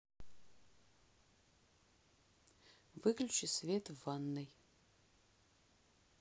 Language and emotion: Russian, neutral